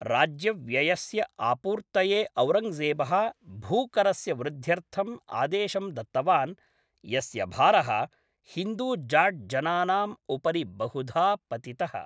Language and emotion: Sanskrit, neutral